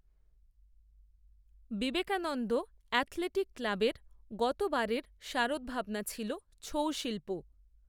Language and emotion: Bengali, neutral